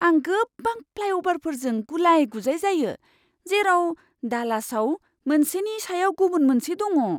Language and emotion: Bodo, surprised